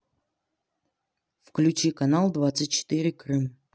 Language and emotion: Russian, neutral